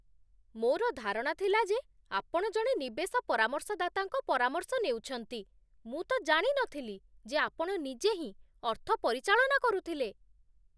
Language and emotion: Odia, surprised